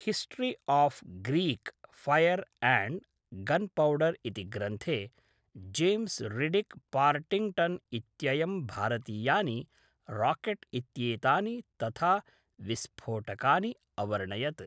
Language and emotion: Sanskrit, neutral